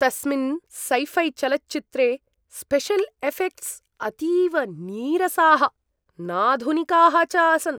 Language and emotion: Sanskrit, disgusted